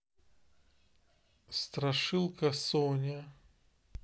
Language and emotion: Russian, neutral